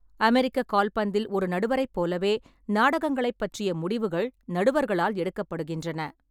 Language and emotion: Tamil, neutral